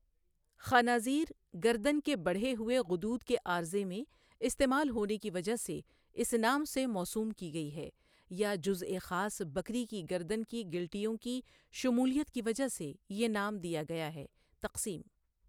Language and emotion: Urdu, neutral